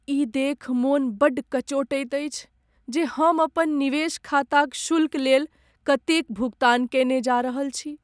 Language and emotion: Maithili, sad